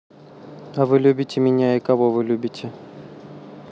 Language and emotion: Russian, neutral